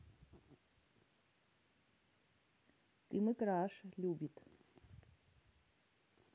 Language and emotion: Russian, neutral